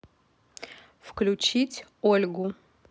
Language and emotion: Russian, neutral